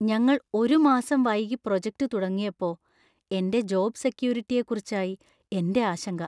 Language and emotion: Malayalam, fearful